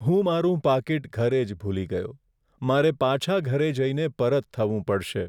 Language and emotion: Gujarati, sad